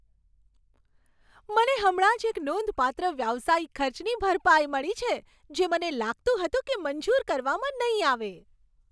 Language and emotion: Gujarati, happy